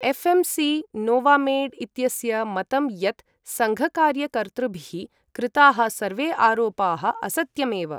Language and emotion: Sanskrit, neutral